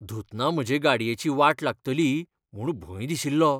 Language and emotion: Goan Konkani, fearful